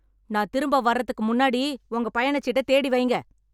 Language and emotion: Tamil, angry